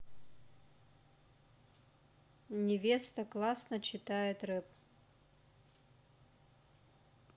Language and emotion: Russian, neutral